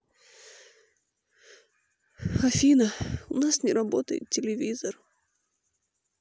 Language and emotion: Russian, sad